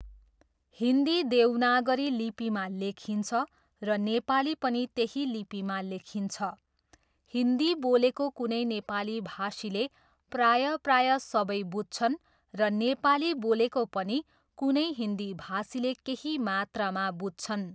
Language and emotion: Nepali, neutral